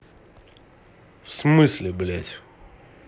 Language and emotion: Russian, angry